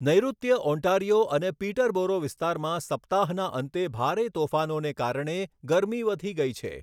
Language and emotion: Gujarati, neutral